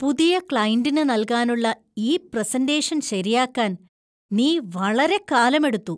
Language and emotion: Malayalam, disgusted